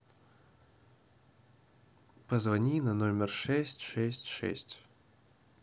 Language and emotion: Russian, neutral